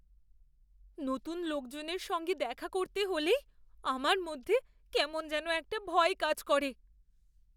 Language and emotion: Bengali, fearful